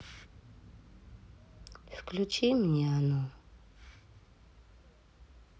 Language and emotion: Russian, sad